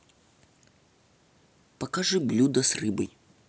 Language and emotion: Russian, neutral